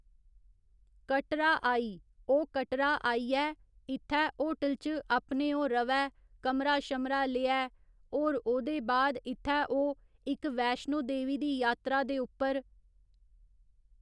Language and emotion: Dogri, neutral